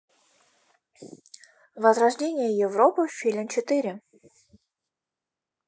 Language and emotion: Russian, neutral